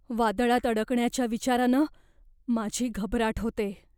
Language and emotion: Marathi, fearful